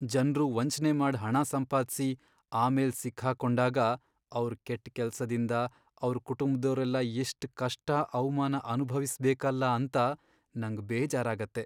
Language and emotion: Kannada, sad